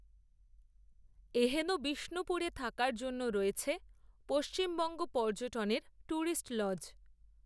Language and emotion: Bengali, neutral